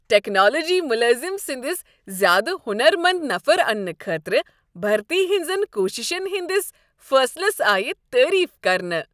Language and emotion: Kashmiri, happy